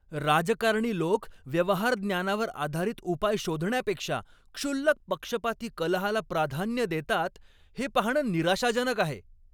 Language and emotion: Marathi, angry